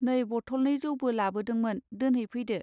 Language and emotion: Bodo, neutral